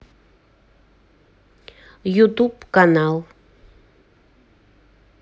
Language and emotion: Russian, neutral